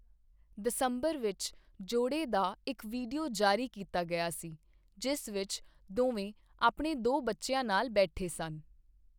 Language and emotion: Punjabi, neutral